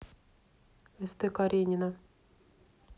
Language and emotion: Russian, neutral